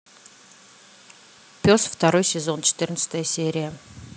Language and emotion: Russian, neutral